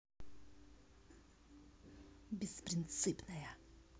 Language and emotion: Russian, angry